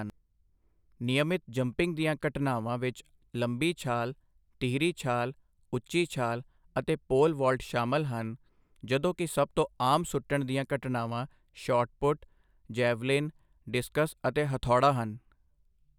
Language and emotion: Punjabi, neutral